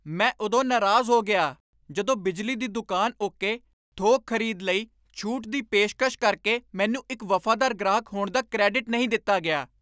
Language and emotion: Punjabi, angry